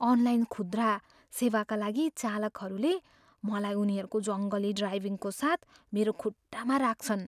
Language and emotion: Nepali, fearful